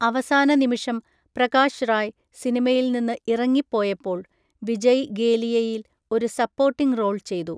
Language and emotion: Malayalam, neutral